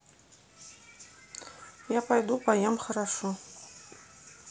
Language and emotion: Russian, neutral